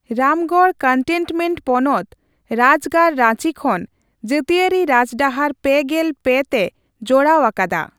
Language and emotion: Santali, neutral